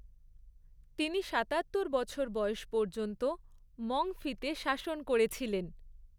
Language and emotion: Bengali, neutral